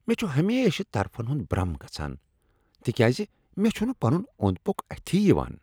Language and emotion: Kashmiri, disgusted